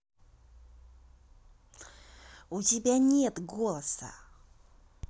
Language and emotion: Russian, angry